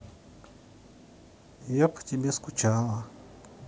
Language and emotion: Russian, sad